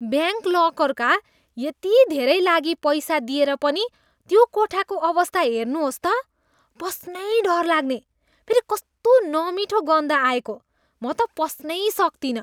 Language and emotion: Nepali, disgusted